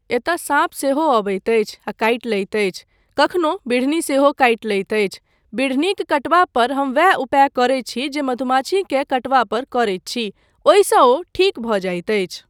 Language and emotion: Maithili, neutral